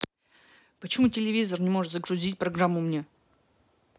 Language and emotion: Russian, angry